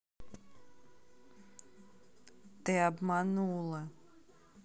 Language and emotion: Russian, sad